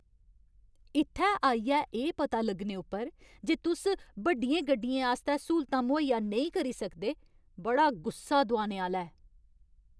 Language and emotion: Dogri, angry